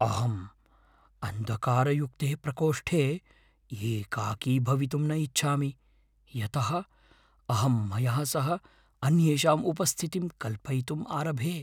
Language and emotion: Sanskrit, fearful